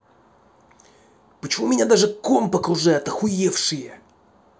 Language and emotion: Russian, angry